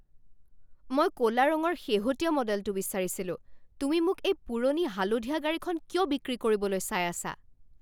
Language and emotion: Assamese, angry